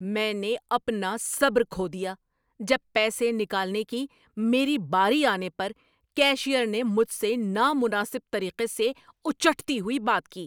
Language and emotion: Urdu, angry